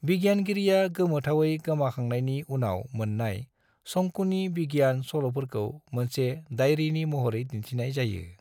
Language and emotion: Bodo, neutral